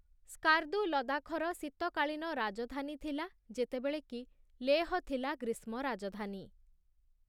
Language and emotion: Odia, neutral